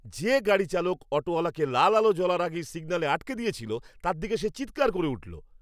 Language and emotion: Bengali, angry